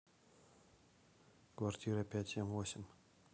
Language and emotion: Russian, neutral